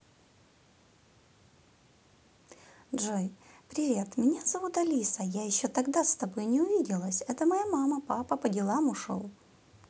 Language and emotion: Russian, positive